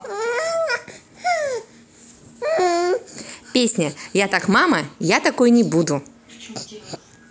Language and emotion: Russian, positive